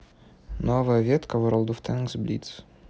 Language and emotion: Russian, neutral